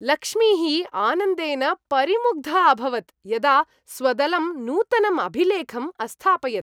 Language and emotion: Sanskrit, happy